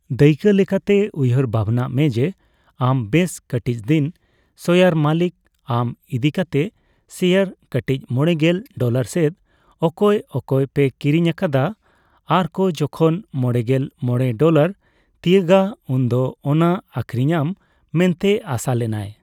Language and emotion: Santali, neutral